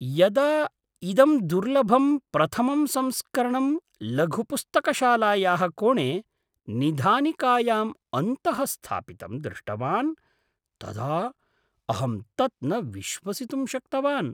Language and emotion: Sanskrit, surprised